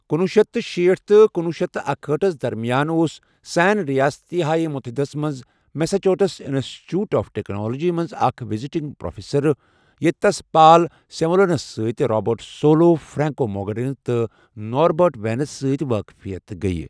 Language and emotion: Kashmiri, neutral